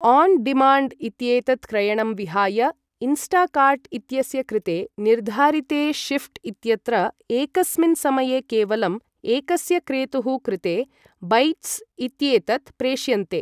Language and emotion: Sanskrit, neutral